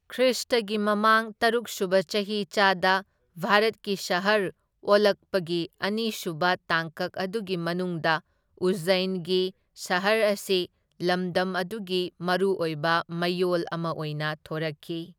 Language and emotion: Manipuri, neutral